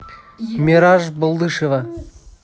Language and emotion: Russian, neutral